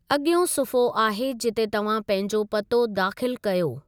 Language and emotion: Sindhi, neutral